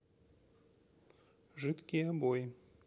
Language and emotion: Russian, neutral